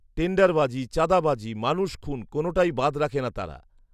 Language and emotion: Bengali, neutral